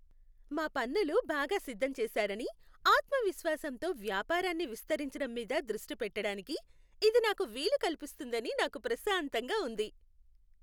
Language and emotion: Telugu, happy